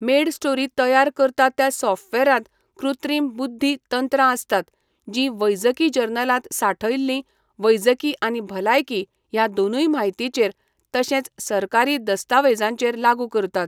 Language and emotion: Goan Konkani, neutral